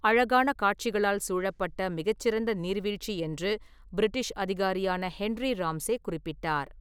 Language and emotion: Tamil, neutral